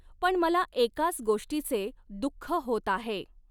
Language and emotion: Marathi, neutral